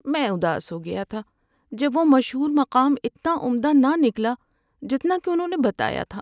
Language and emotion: Urdu, sad